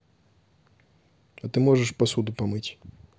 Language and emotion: Russian, neutral